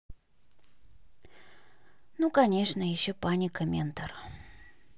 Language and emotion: Russian, sad